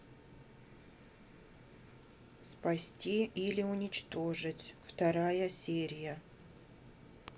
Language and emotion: Russian, neutral